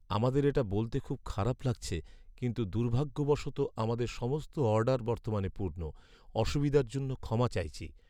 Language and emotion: Bengali, sad